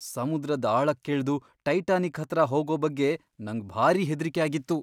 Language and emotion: Kannada, fearful